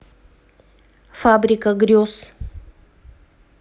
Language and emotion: Russian, neutral